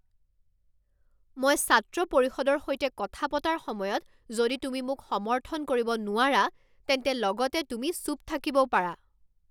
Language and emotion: Assamese, angry